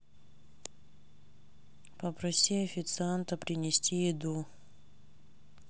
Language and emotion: Russian, sad